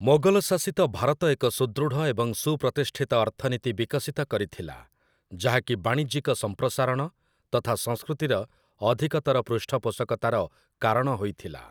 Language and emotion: Odia, neutral